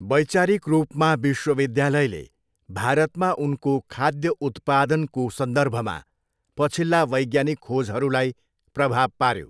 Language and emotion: Nepali, neutral